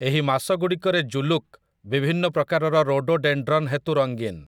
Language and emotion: Odia, neutral